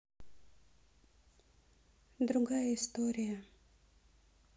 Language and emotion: Russian, neutral